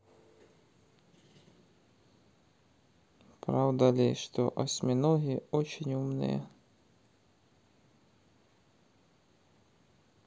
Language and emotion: Russian, sad